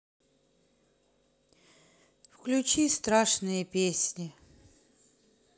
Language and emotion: Russian, sad